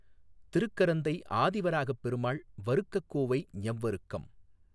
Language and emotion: Tamil, neutral